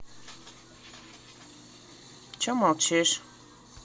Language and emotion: Russian, neutral